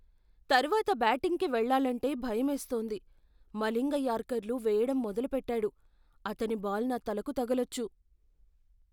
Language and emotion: Telugu, fearful